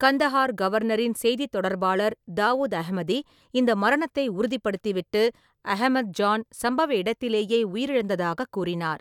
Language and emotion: Tamil, neutral